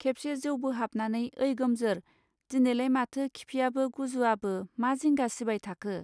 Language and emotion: Bodo, neutral